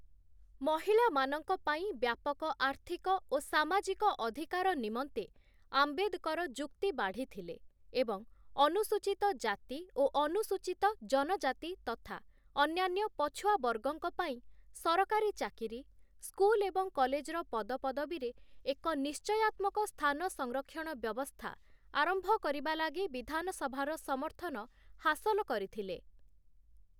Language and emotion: Odia, neutral